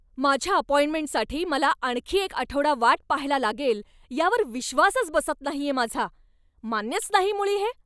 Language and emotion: Marathi, angry